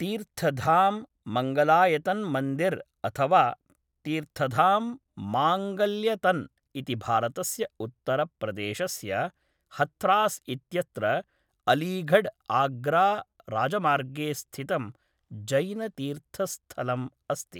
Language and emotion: Sanskrit, neutral